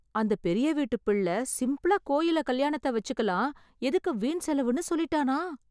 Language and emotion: Tamil, surprised